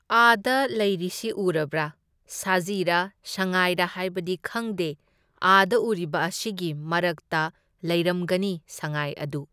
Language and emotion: Manipuri, neutral